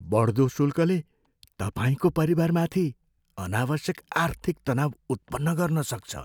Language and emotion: Nepali, fearful